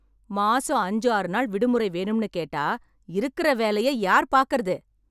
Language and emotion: Tamil, angry